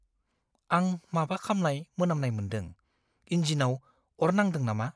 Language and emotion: Bodo, fearful